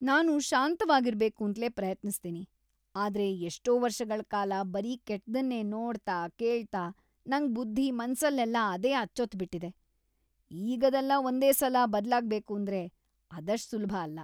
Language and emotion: Kannada, disgusted